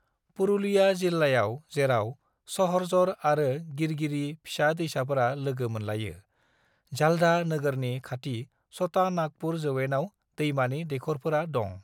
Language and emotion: Bodo, neutral